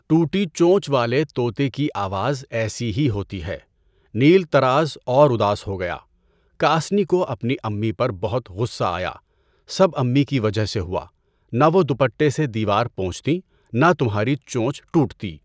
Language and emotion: Urdu, neutral